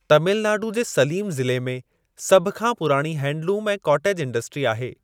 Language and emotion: Sindhi, neutral